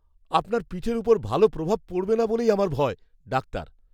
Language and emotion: Bengali, fearful